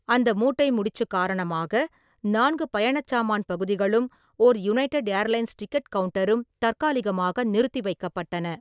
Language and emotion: Tamil, neutral